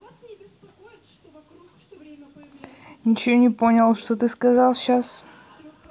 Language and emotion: Russian, neutral